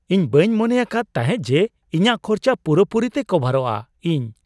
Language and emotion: Santali, surprised